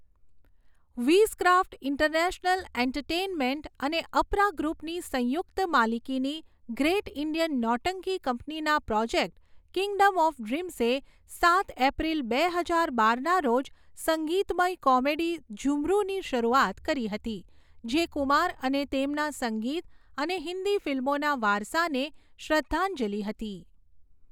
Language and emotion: Gujarati, neutral